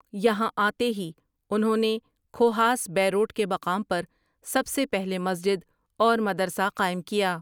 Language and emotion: Urdu, neutral